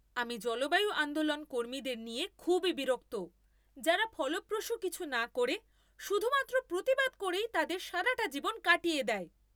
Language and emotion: Bengali, angry